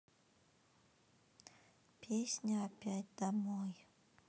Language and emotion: Russian, sad